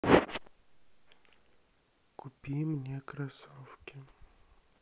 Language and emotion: Russian, neutral